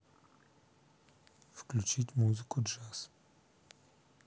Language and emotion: Russian, neutral